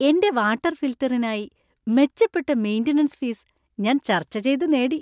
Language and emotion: Malayalam, happy